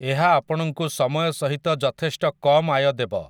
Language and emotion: Odia, neutral